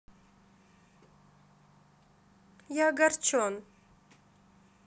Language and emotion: Russian, sad